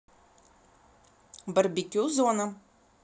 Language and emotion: Russian, neutral